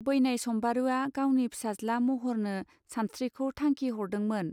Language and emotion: Bodo, neutral